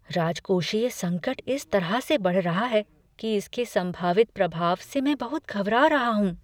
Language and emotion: Hindi, fearful